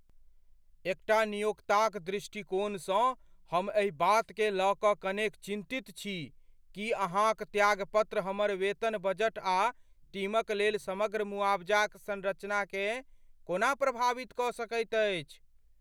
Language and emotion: Maithili, fearful